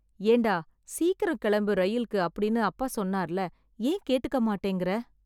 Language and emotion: Tamil, sad